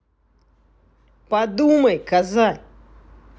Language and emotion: Russian, angry